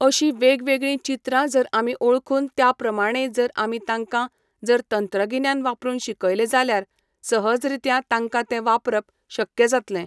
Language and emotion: Goan Konkani, neutral